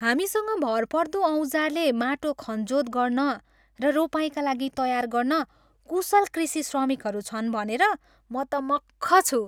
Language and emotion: Nepali, happy